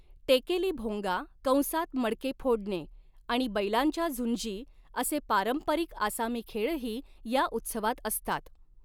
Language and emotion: Marathi, neutral